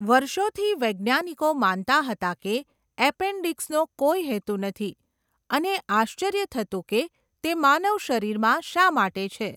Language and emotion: Gujarati, neutral